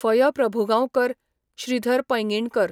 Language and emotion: Goan Konkani, neutral